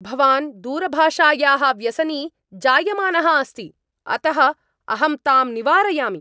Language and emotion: Sanskrit, angry